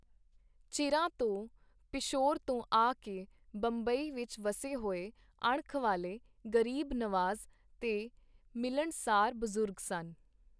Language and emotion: Punjabi, neutral